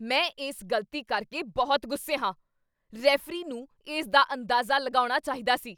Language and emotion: Punjabi, angry